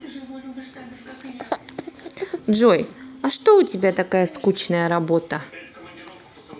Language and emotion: Russian, neutral